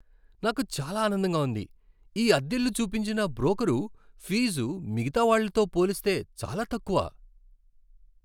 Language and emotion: Telugu, happy